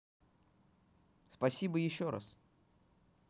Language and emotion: Russian, positive